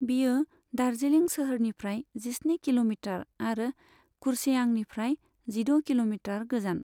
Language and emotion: Bodo, neutral